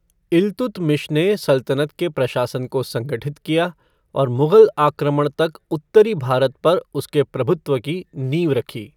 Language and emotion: Hindi, neutral